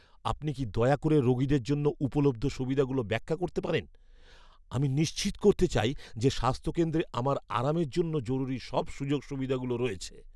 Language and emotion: Bengali, fearful